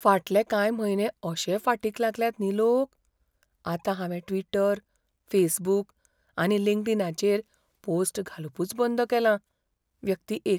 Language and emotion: Goan Konkani, fearful